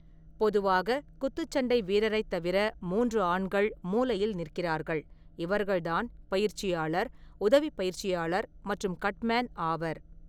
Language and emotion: Tamil, neutral